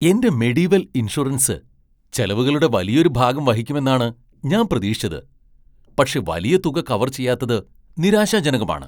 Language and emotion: Malayalam, surprised